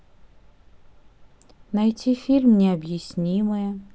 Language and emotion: Russian, neutral